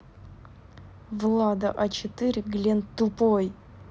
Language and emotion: Russian, angry